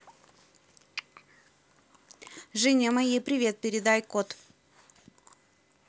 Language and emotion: Russian, neutral